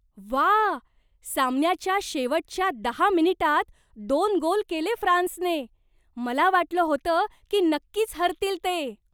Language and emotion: Marathi, surprised